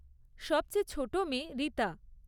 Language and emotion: Bengali, neutral